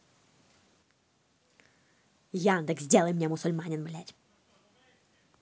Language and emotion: Russian, angry